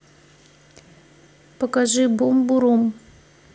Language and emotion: Russian, neutral